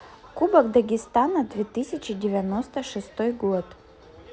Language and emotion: Russian, neutral